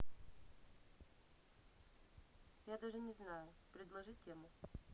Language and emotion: Russian, neutral